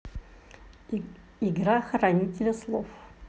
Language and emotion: Russian, neutral